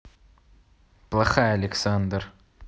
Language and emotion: Russian, neutral